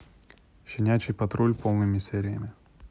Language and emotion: Russian, neutral